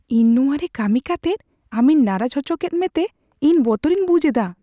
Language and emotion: Santali, fearful